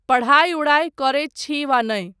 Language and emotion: Maithili, neutral